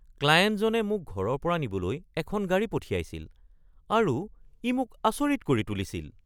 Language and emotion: Assamese, surprised